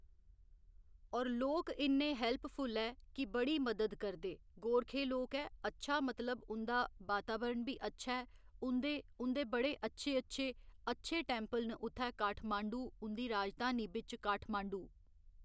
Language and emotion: Dogri, neutral